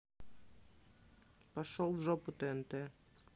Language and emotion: Russian, neutral